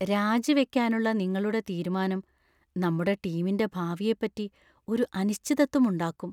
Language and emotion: Malayalam, fearful